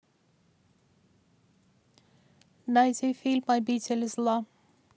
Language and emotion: Russian, neutral